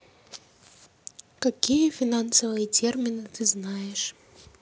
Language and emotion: Russian, neutral